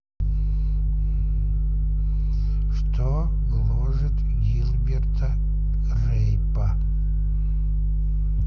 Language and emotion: Russian, neutral